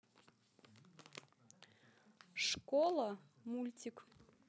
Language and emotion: Russian, neutral